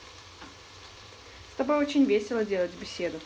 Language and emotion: Russian, positive